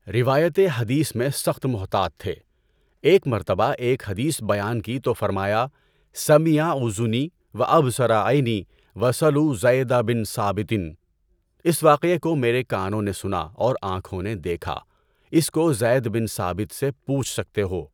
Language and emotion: Urdu, neutral